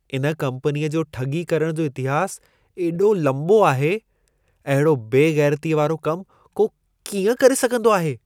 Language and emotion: Sindhi, disgusted